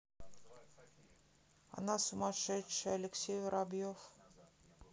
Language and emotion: Russian, neutral